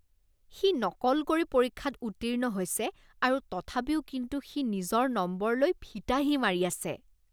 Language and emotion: Assamese, disgusted